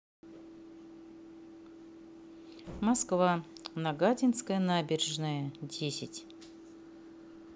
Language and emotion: Russian, neutral